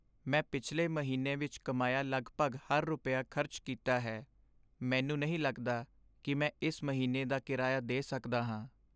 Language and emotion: Punjabi, sad